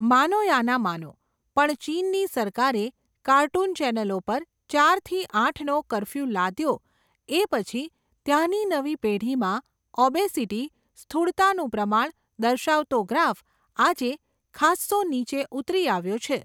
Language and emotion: Gujarati, neutral